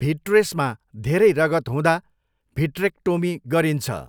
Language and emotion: Nepali, neutral